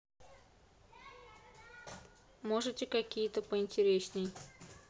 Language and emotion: Russian, neutral